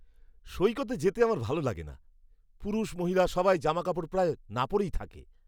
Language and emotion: Bengali, disgusted